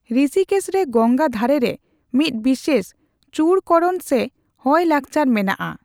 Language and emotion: Santali, neutral